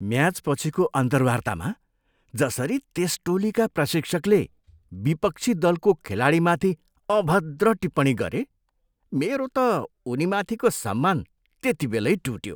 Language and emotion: Nepali, disgusted